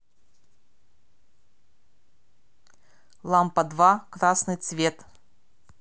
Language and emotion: Russian, neutral